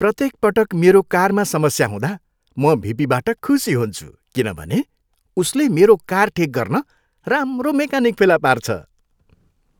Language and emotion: Nepali, happy